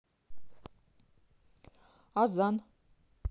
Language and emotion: Russian, neutral